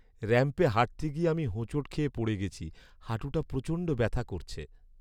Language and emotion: Bengali, sad